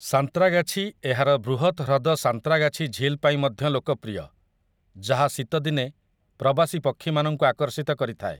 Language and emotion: Odia, neutral